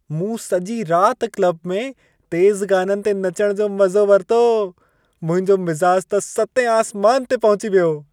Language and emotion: Sindhi, happy